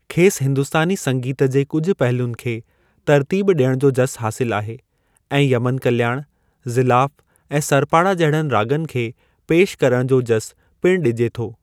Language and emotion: Sindhi, neutral